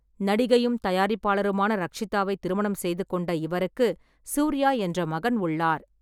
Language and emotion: Tamil, neutral